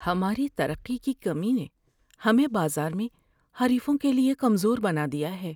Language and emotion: Urdu, sad